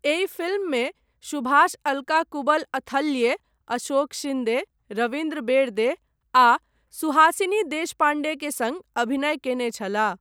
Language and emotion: Maithili, neutral